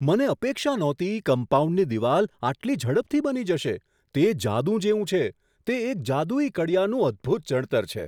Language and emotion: Gujarati, surprised